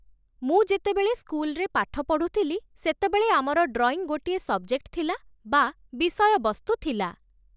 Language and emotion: Odia, neutral